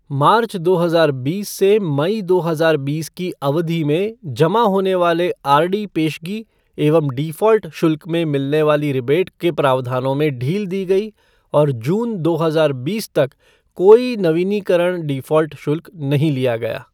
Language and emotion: Hindi, neutral